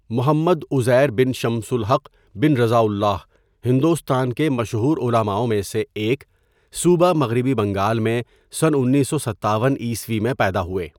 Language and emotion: Urdu, neutral